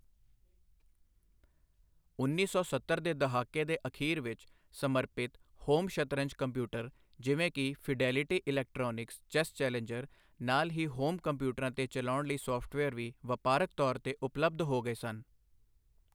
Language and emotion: Punjabi, neutral